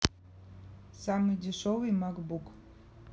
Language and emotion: Russian, neutral